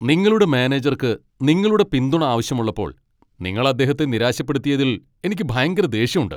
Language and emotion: Malayalam, angry